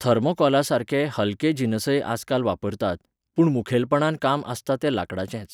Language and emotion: Goan Konkani, neutral